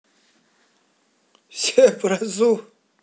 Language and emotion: Russian, positive